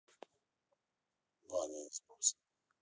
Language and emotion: Russian, neutral